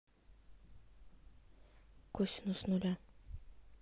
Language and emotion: Russian, neutral